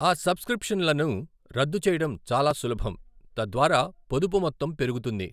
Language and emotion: Telugu, neutral